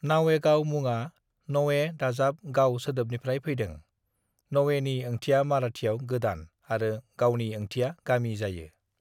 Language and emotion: Bodo, neutral